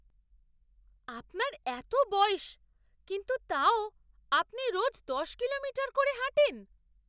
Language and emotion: Bengali, surprised